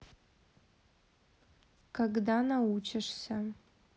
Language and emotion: Russian, neutral